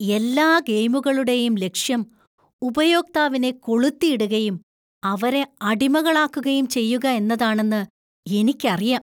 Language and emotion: Malayalam, disgusted